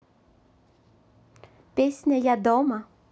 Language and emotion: Russian, positive